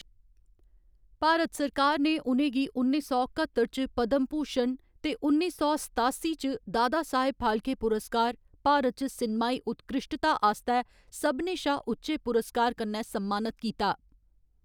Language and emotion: Dogri, neutral